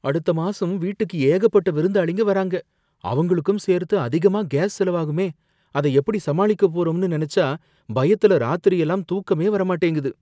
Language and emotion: Tamil, fearful